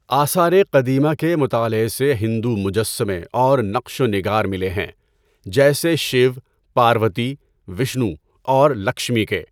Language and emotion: Urdu, neutral